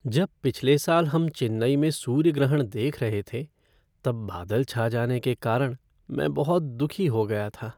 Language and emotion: Hindi, sad